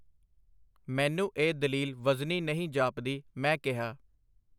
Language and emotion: Punjabi, neutral